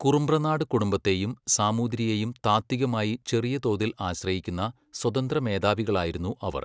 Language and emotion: Malayalam, neutral